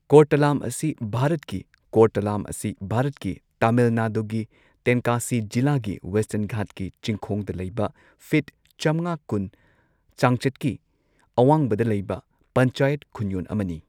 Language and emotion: Manipuri, neutral